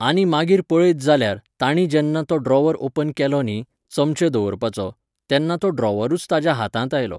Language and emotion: Goan Konkani, neutral